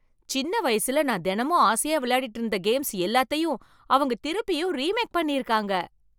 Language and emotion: Tamil, surprised